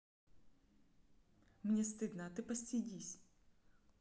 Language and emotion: Russian, neutral